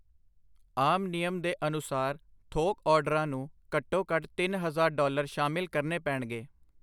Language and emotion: Punjabi, neutral